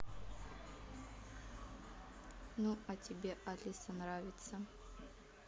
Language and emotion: Russian, neutral